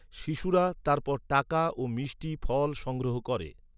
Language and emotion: Bengali, neutral